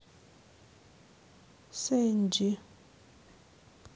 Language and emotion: Russian, sad